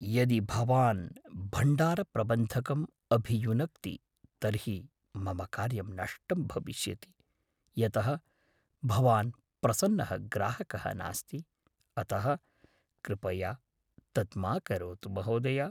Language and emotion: Sanskrit, fearful